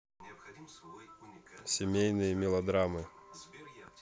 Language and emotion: Russian, neutral